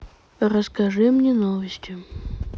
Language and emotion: Russian, neutral